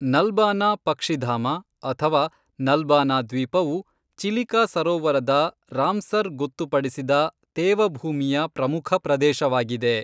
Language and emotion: Kannada, neutral